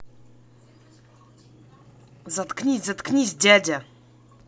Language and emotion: Russian, angry